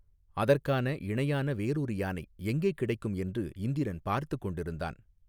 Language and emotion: Tamil, neutral